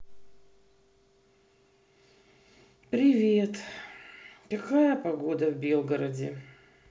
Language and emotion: Russian, sad